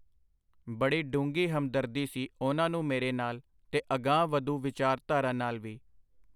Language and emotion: Punjabi, neutral